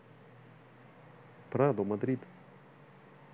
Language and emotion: Russian, neutral